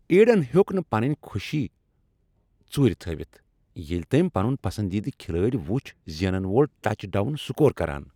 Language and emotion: Kashmiri, happy